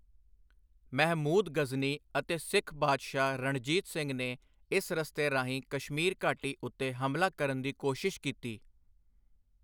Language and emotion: Punjabi, neutral